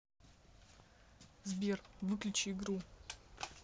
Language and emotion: Russian, angry